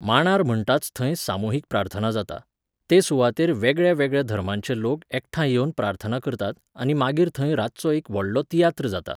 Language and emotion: Goan Konkani, neutral